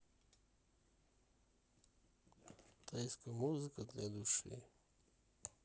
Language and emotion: Russian, neutral